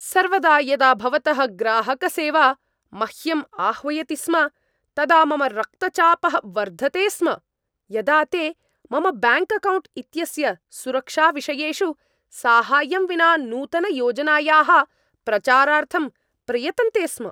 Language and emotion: Sanskrit, angry